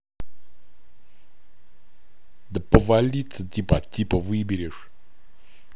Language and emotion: Russian, angry